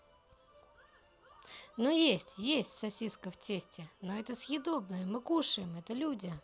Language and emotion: Russian, positive